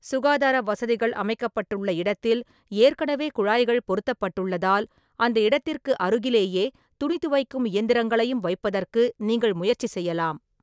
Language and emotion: Tamil, neutral